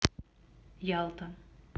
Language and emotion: Russian, neutral